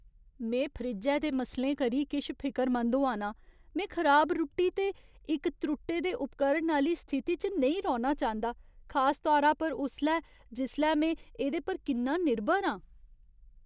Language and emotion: Dogri, fearful